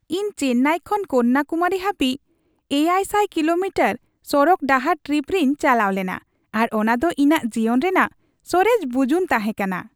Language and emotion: Santali, happy